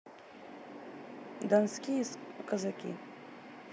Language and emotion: Russian, neutral